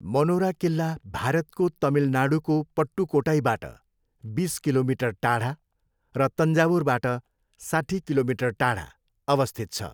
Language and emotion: Nepali, neutral